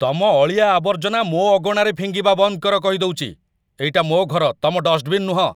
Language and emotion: Odia, angry